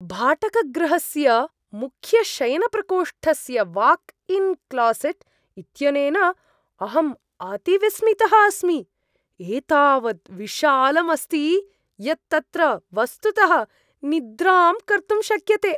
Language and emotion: Sanskrit, surprised